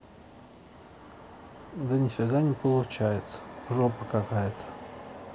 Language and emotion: Russian, sad